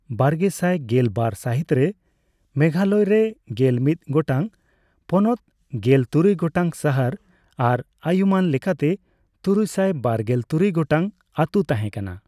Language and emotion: Santali, neutral